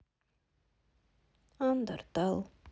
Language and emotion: Russian, sad